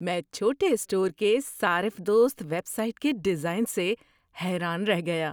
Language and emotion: Urdu, surprised